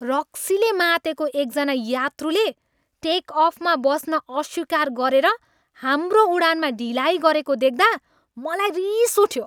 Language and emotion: Nepali, angry